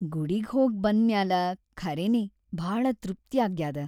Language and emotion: Kannada, happy